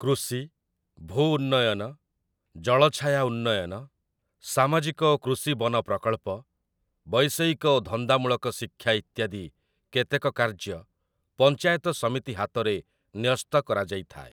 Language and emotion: Odia, neutral